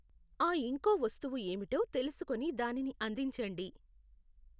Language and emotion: Telugu, neutral